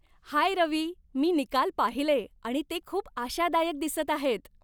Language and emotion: Marathi, happy